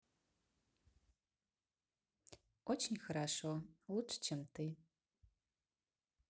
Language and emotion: Russian, positive